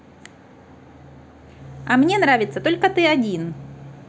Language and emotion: Russian, neutral